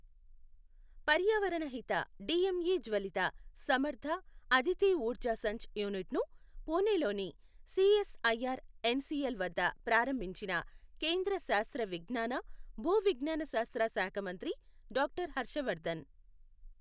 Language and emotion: Telugu, neutral